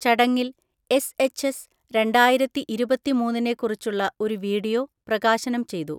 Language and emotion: Malayalam, neutral